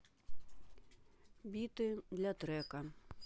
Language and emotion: Russian, neutral